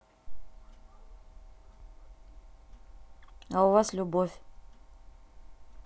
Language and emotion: Russian, neutral